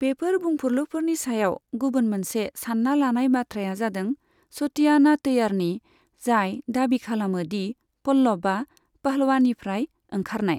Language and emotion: Bodo, neutral